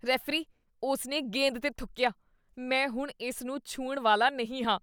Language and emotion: Punjabi, disgusted